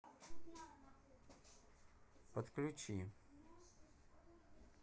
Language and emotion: Russian, neutral